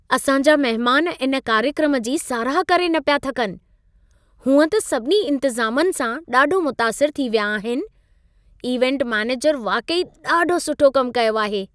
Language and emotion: Sindhi, happy